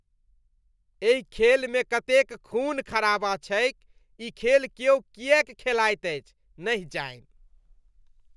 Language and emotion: Maithili, disgusted